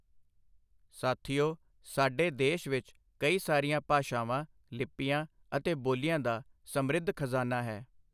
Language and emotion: Punjabi, neutral